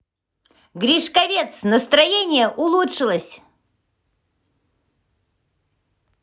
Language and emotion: Russian, positive